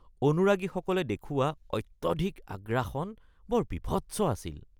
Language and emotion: Assamese, disgusted